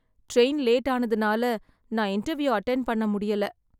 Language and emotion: Tamil, sad